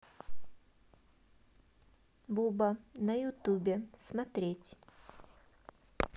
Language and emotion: Russian, neutral